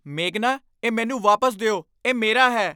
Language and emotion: Punjabi, angry